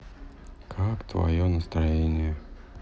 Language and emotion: Russian, sad